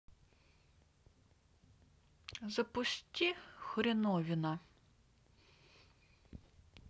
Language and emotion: Russian, neutral